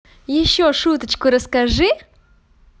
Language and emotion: Russian, positive